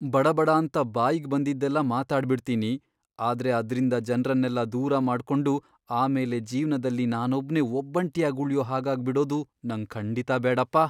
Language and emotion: Kannada, fearful